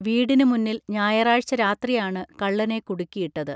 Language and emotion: Malayalam, neutral